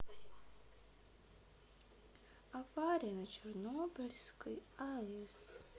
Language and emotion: Russian, neutral